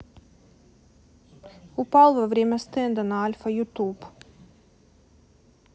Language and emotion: Russian, neutral